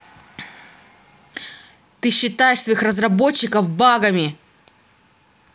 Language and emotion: Russian, angry